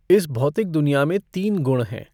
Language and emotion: Hindi, neutral